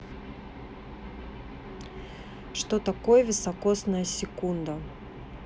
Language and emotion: Russian, neutral